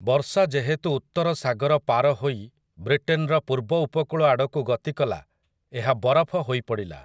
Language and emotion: Odia, neutral